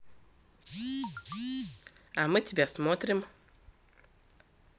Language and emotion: Russian, positive